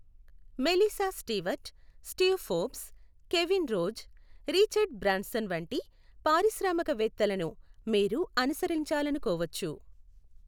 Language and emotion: Telugu, neutral